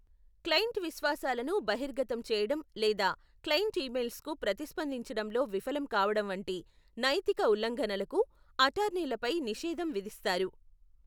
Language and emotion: Telugu, neutral